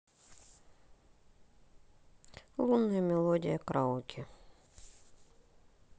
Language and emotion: Russian, sad